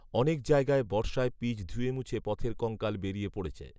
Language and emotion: Bengali, neutral